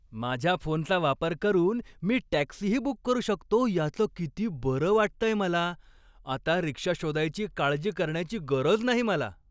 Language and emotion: Marathi, happy